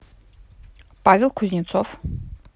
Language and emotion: Russian, neutral